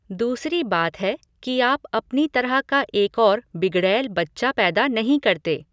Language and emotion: Hindi, neutral